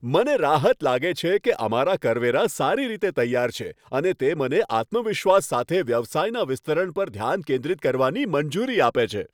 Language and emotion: Gujarati, happy